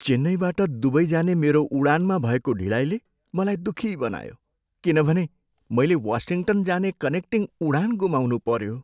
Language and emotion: Nepali, sad